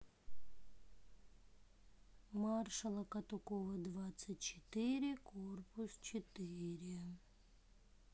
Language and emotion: Russian, sad